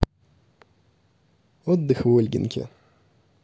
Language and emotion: Russian, positive